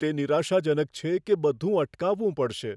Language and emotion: Gujarati, fearful